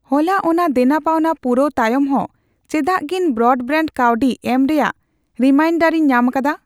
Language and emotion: Santali, neutral